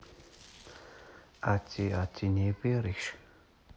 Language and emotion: Russian, neutral